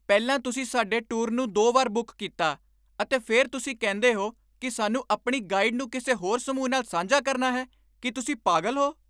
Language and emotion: Punjabi, angry